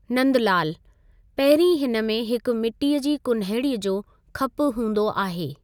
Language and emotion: Sindhi, neutral